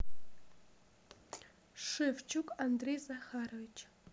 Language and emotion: Russian, neutral